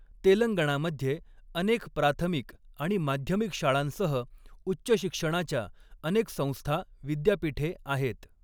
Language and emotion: Marathi, neutral